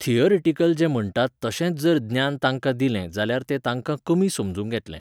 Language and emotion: Goan Konkani, neutral